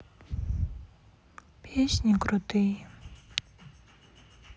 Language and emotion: Russian, sad